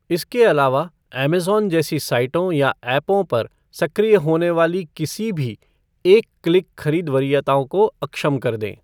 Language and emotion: Hindi, neutral